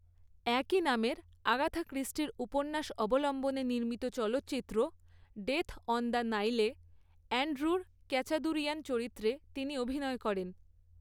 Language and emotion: Bengali, neutral